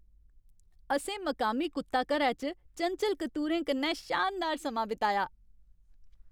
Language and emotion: Dogri, happy